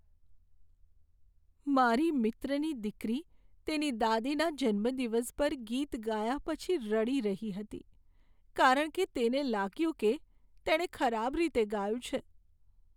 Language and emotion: Gujarati, sad